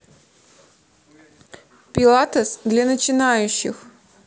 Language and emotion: Russian, neutral